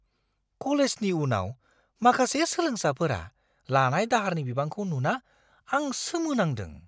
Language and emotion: Bodo, surprised